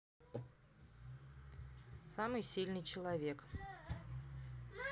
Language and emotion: Russian, neutral